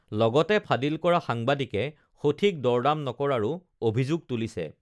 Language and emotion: Assamese, neutral